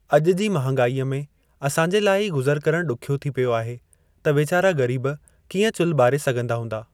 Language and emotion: Sindhi, neutral